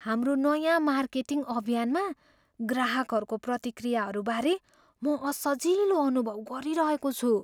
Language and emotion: Nepali, fearful